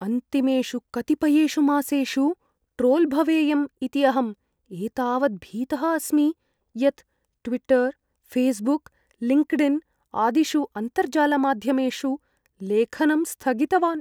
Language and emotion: Sanskrit, fearful